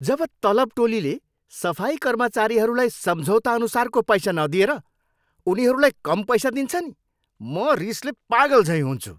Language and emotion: Nepali, angry